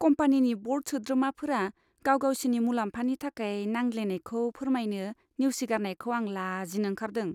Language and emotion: Bodo, disgusted